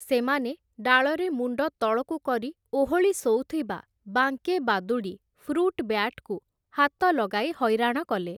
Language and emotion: Odia, neutral